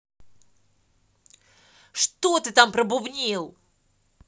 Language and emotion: Russian, angry